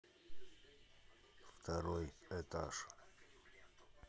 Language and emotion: Russian, neutral